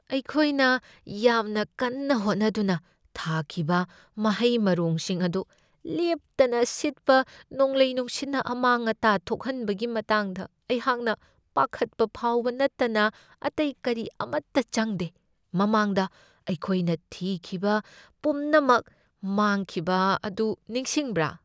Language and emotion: Manipuri, fearful